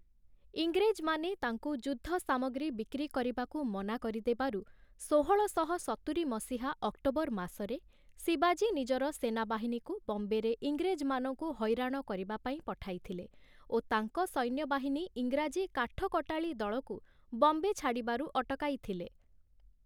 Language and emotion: Odia, neutral